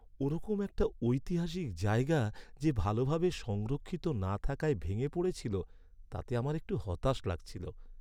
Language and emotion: Bengali, sad